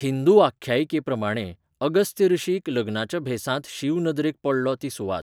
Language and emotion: Goan Konkani, neutral